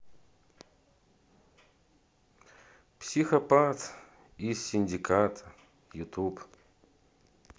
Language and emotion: Russian, neutral